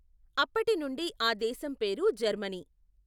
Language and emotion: Telugu, neutral